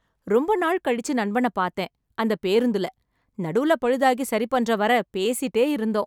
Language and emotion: Tamil, happy